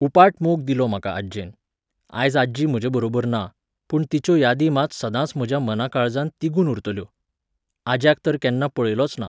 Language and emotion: Goan Konkani, neutral